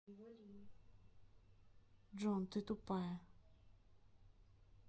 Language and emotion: Russian, neutral